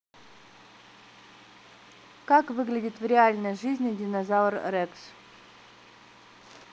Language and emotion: Russian, neutral